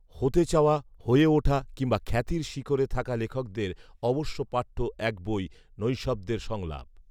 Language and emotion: Bengali, neutral